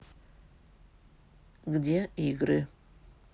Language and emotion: Russian, neutral